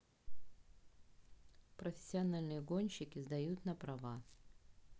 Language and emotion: Russian, neutral